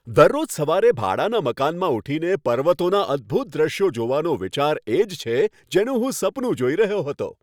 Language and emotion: Gujarati, happy